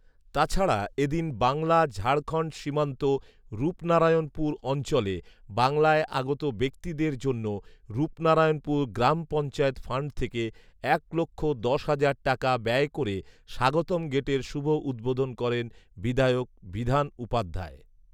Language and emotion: Bengali, neutral